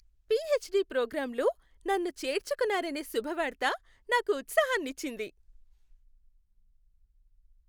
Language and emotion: Telugu, happy